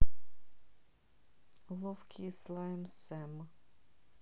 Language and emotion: Russian, neutral